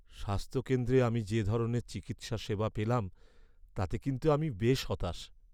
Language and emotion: Bengali, sad